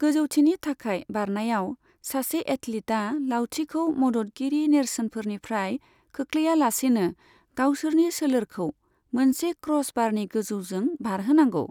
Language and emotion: Bodo, neutral